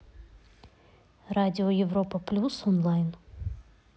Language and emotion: Russian, neutral